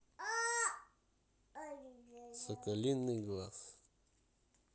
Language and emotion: Russian, neutral